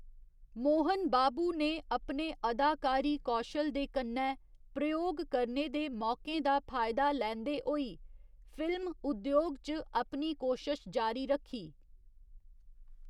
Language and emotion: Dogri, neutral